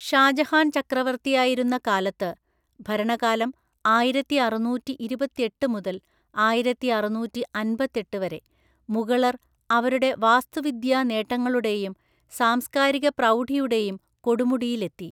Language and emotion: Malayalam, neutral